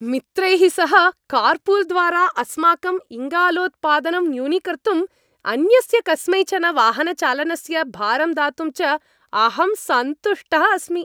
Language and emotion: Sanskrit, happy